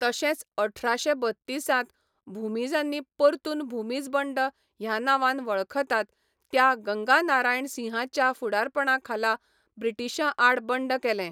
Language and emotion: Goan Konkani, neutral